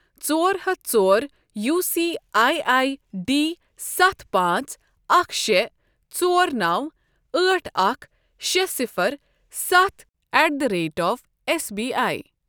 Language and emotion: Kashmiri, neutral